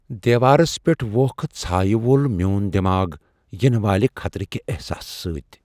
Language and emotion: Kashmiri, fearful